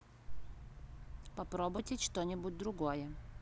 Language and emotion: Russian, neutral